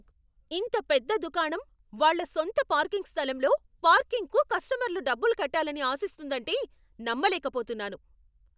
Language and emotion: Telugu, angry